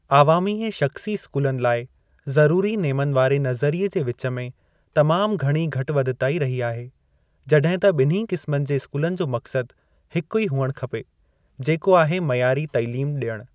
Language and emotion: Sindhi, neutral